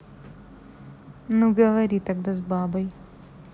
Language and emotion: Russian, neutral